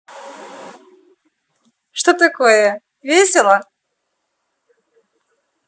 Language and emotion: Russian, positive